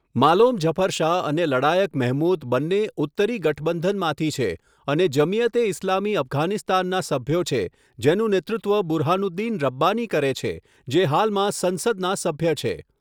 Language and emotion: Gujarati, neutral